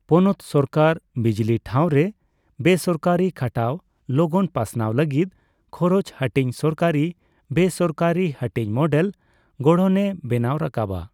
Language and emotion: Santali, neutral